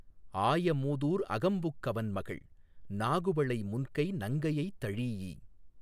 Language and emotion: Tamil, neutral